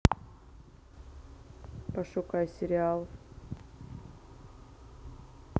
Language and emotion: Russian, neutral